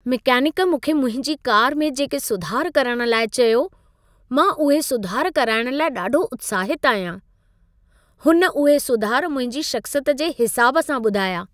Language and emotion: Sindhi, happy